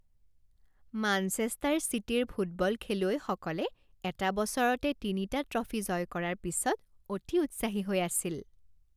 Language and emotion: Assamese, happy